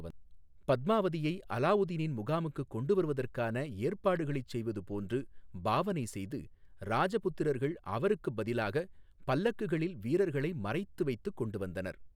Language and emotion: Tamil, neutral